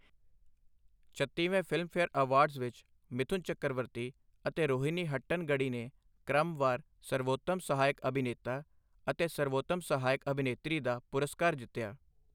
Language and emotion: Punjabi, neutral